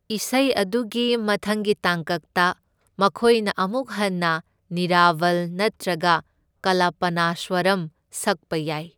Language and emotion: Manipuri, neutral